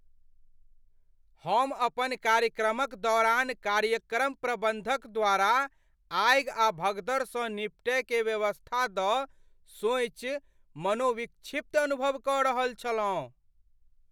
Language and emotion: Maithili, fearful